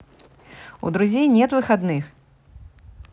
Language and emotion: Russian, positive